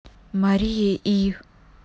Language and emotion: Russian, neutral